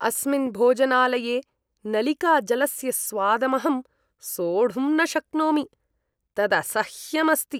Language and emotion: Sanskrit, disgusted